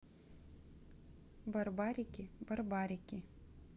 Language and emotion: Russian, neutral